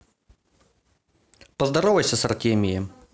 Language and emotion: Russian, neutral